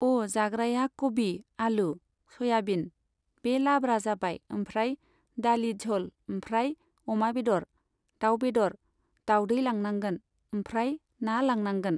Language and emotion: Bodo, neutral